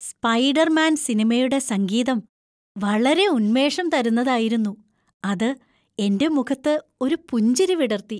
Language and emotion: Malayalam, happy